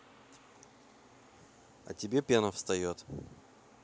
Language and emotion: Russian, neutral